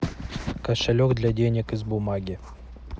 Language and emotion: Russian, neutral